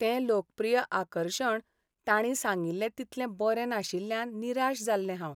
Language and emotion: Goan Konkani, sad